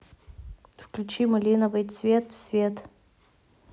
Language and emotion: Russian, neutral